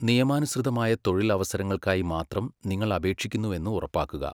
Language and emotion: Malayalam, neutral